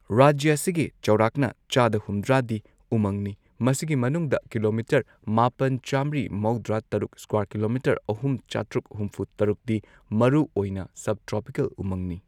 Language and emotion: Manipuri, neutral